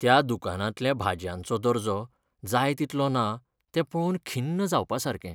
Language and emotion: Goan Konkani, sad